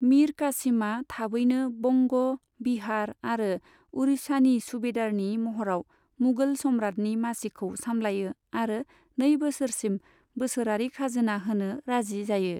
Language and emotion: Bodo, neutral